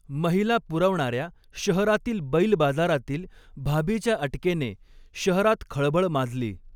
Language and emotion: Marathi, neutral